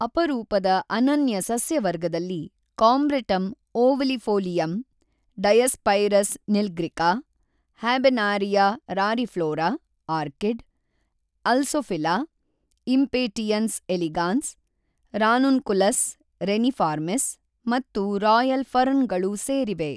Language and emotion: Kannada, neutral